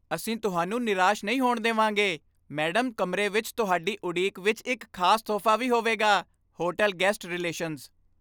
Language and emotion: Punjabi, happy